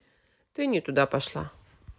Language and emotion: Russian, neutral